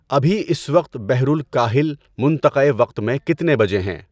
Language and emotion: Urdu, neutral